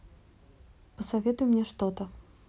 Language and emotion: Russian, neutral